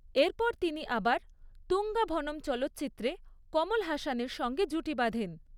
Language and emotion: Bengali, neutral